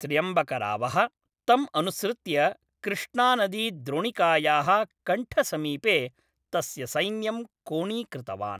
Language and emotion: Sanskrit, neutral